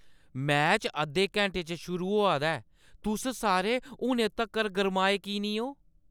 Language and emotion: Dogri, angry